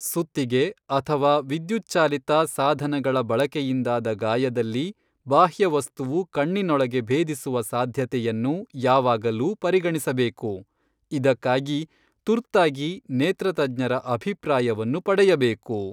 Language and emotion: Kannada, neutral